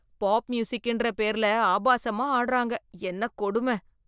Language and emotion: Tamil, disgusted